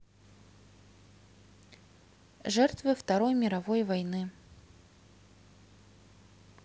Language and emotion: Russian, neutral